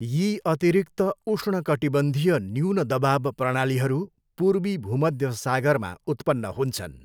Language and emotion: Nepali, neutral